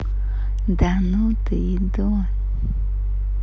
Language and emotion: Russian, positive